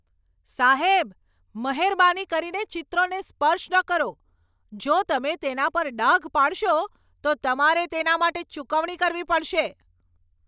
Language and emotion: Gujarati, angry